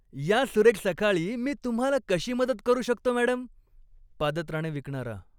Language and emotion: Marathi, happy